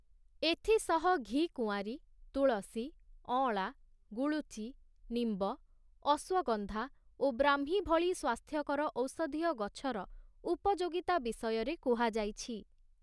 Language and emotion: Odia, neutral